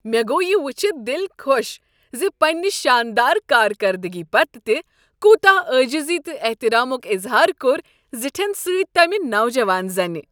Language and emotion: Kashmiri, happy